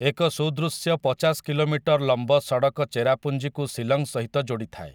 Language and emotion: Odia, neutral